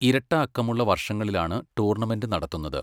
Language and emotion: Malayalam, neutral